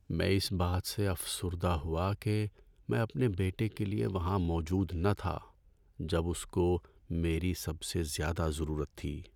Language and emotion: Urdu, sad